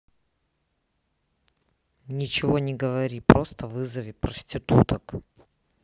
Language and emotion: Russian, neutral